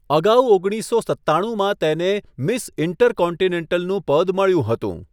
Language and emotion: Gujarati, neutral